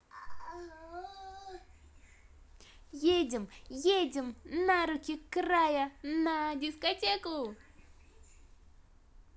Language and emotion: Russian, positive